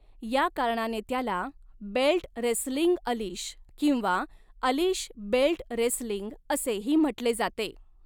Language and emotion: Marathi, neutral